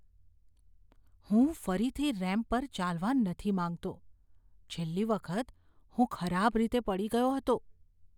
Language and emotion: Gujarati, fearful